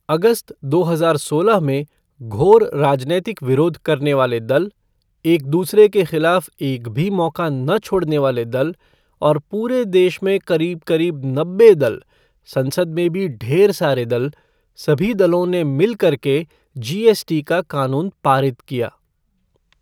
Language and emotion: Hindi, neutral